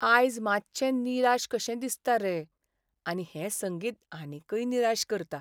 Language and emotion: Goan Konkani, sad